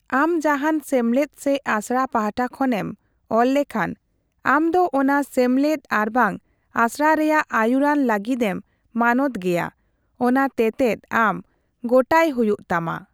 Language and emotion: Santali, neutral